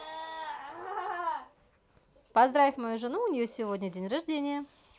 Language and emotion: Russian, positive